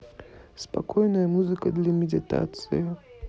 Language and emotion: Russian, neutral